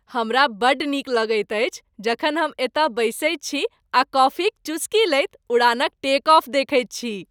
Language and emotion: Maithili, happy